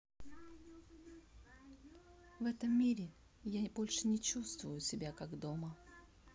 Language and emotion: Russian, sad